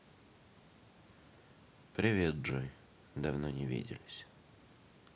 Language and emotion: Russian, sad